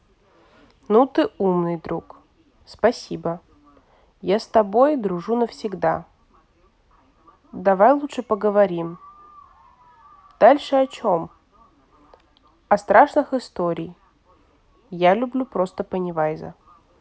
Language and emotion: Russian, neutral